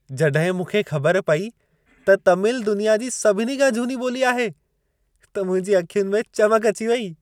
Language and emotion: Sindhi, happy